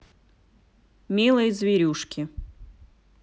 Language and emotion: Russian, neutral